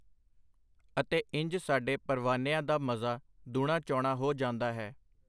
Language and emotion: Punjabi, neutral